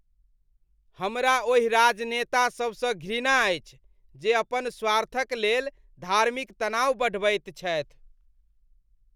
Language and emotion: Maithili, disgusted